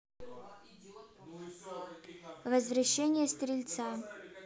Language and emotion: Russian, neutral